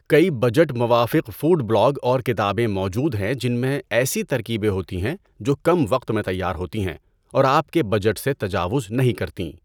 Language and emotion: Urdu, neutral